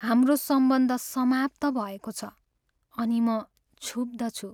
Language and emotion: Nepali, sad